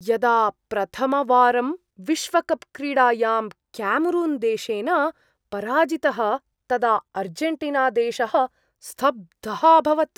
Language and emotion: Sanskrit, surprised